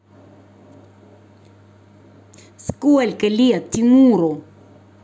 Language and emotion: Russian, angry